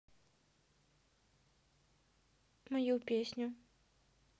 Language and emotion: Russian, neutral